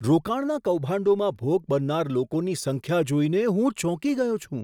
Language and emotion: Gujarati, surprised